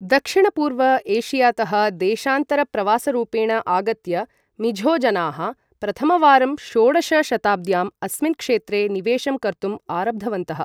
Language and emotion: Sanskrit, neutral